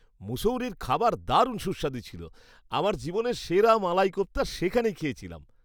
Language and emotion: Bengali, happy